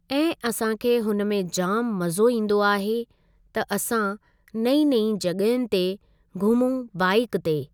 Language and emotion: Sindhi, neutral